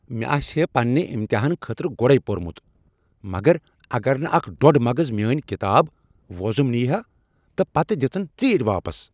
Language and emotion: Kashmiri, angry